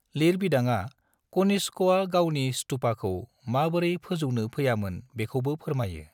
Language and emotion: Bodo, neutral